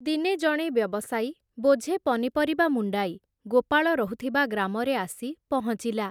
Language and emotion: Odia, neutral